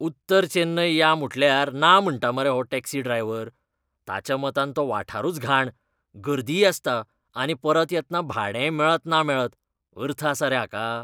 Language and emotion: Goan Konkani, disgusted